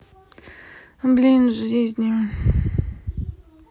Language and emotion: Russian, sad